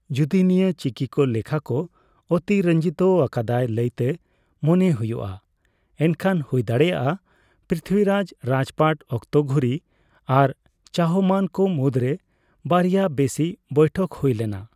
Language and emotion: Santali, neutral